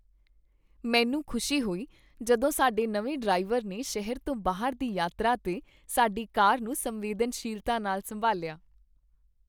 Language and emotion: Punjabi, happy